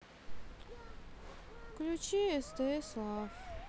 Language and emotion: Russian, sad